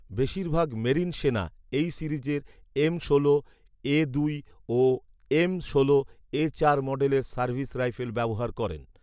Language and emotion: Bengali, neutral